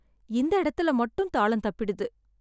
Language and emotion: Tamil, sad